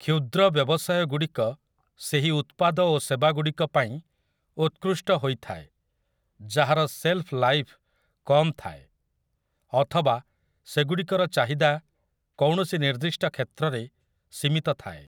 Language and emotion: Odia, neutral